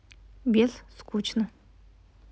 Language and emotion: Russian, neutral